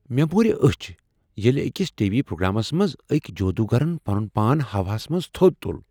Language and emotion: Kashmiri, surprised